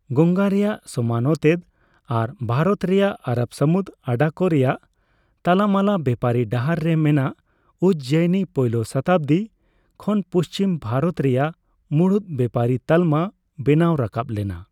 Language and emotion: Santali, neutral